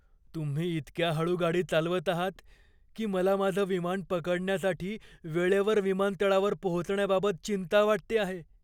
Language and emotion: Marathi, fearful